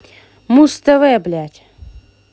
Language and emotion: Russian, angry